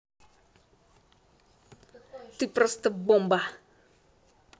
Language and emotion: Russian, positive